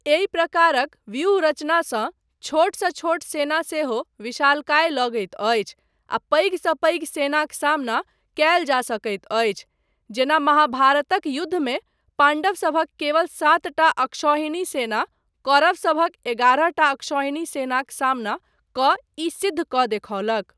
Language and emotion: Maithili, neutral